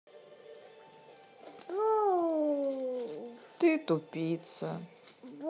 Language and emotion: Russian, sad